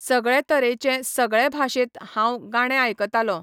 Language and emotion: Goan Konkani, neutral